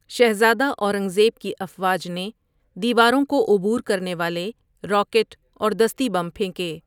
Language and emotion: Urdu, neutral